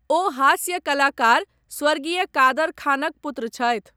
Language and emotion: Maithili, neutral